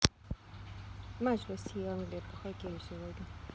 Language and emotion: Russian, neutral